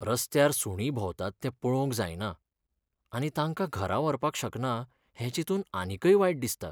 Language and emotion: Goan Konkani, sad